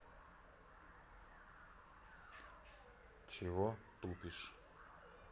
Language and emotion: Russian, neutral